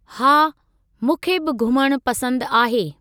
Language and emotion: Sindhi, neutral